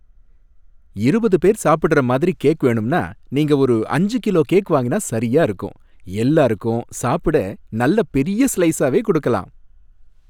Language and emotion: Tamil, happy